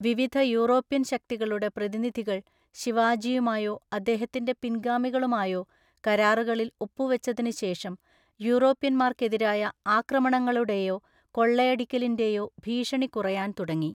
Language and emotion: Malayalam, neutral